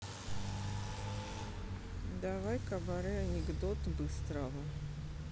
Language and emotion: Russian, neutral